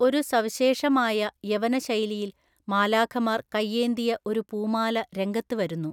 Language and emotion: Malayalam, neutral